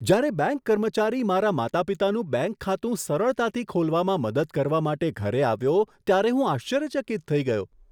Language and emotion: Gujarati, surprised